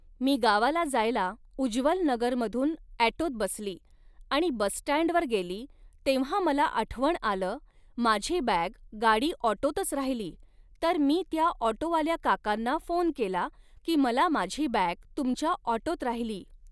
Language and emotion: Marathi, neutral